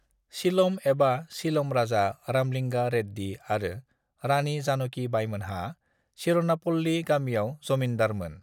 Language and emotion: Bodo, neutral